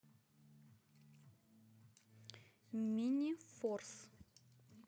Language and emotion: Russian, neutral